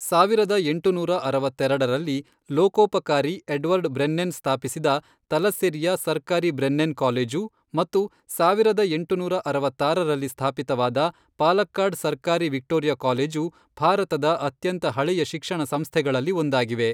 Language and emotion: Kannada, neutral